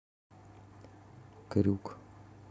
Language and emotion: Russian, neutral